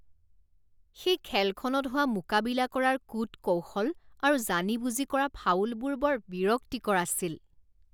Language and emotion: Assamese, disgusted